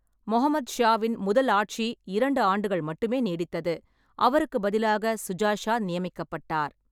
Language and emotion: Tamil, neutral